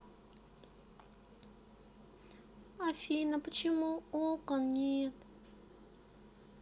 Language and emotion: Russian, sad